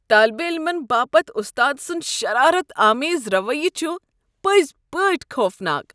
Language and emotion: Kashmiri, disgusted